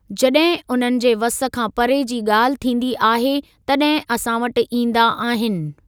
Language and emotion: Sindhi, neutral